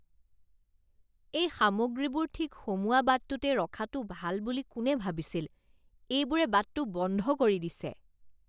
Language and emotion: Assamese, disgusted